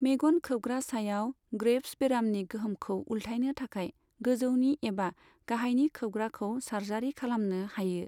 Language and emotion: Bodo, neutral